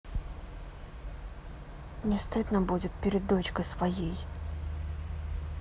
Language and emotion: Russian, sad